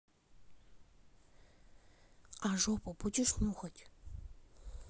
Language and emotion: Russian, neutral